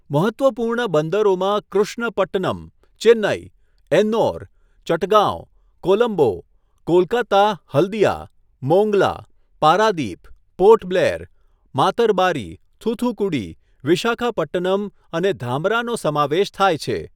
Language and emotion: Gujarati, neutral